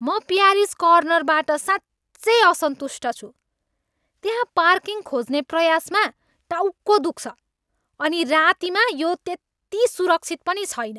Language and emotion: Nepali, angry